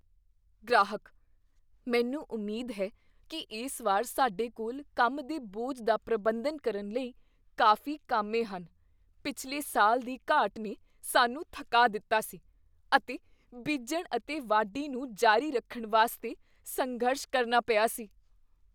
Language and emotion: Punjabi, fearful